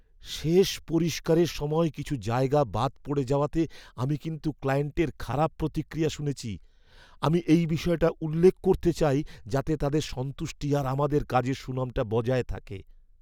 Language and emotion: Bengali, fearful